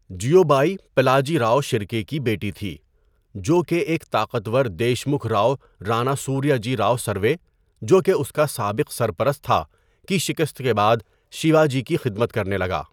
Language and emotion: Urdu, neutral